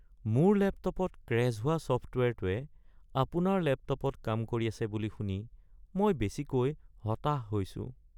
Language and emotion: Assamese, sad